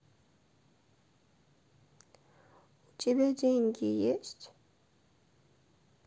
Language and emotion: Russian, sad